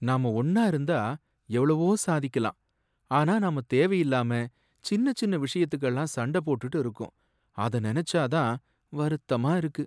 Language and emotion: Tamil, sad